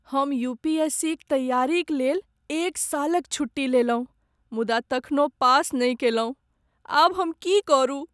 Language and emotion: Maithili, sad